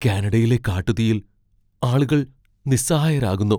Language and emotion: Malayalam, fearful